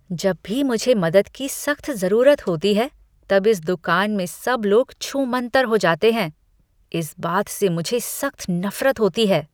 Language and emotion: Hindi, disgusted